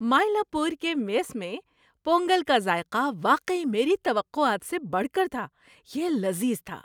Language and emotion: Urdu, happy